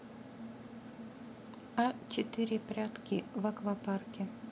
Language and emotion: Russian, neutral